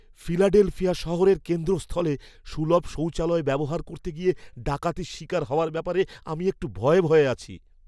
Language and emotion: Bengali, fearful